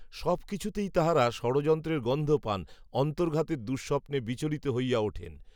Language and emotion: Bengali, neutral